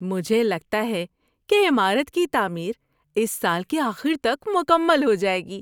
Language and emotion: Urdu, happy